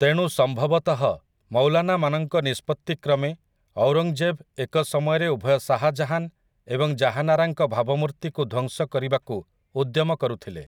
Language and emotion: Odia, neutral